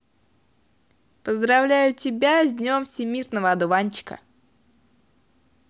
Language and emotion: Russian, positive